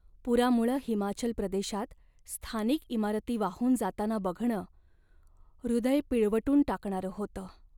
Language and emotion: Marathi, sad